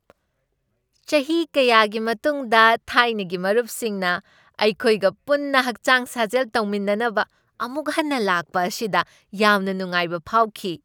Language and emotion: Manipuri, happy